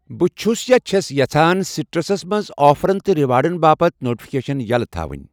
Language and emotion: Kashmiri, neutral